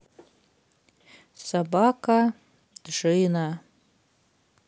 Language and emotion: Russian, neutral